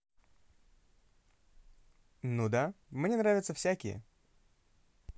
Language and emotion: Russian, positive